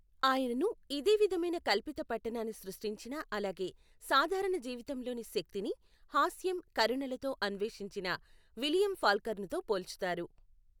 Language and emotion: Telugu, neutral